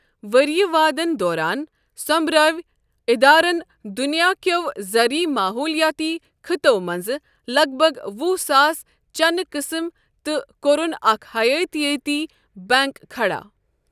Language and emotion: Kashmiri, neutral